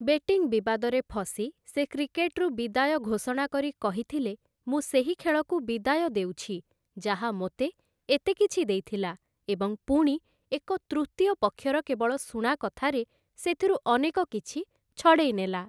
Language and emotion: Odia, neutral